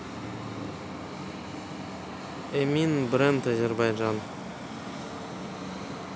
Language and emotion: Russian, neutral